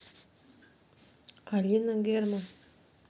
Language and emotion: Russian, neutral